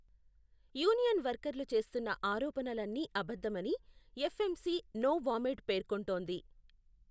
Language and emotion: Telugu, neutral